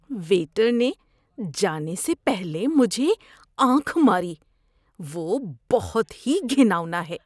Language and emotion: Urdu, disgusted